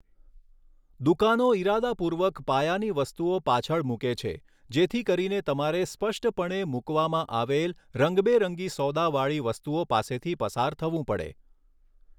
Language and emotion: Gujarati, neutral